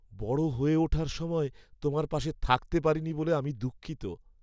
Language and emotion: Bengali, sad